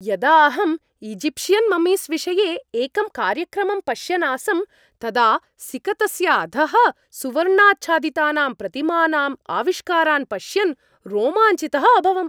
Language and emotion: Sanskrit, happy